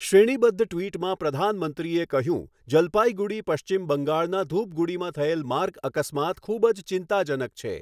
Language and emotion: Gujarati, neutral